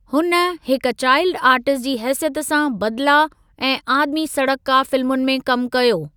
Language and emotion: Sindhi, neutral